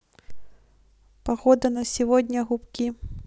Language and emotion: Russian, neutral